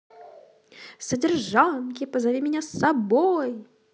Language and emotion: Russian, positive